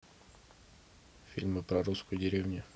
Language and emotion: Russian, neutral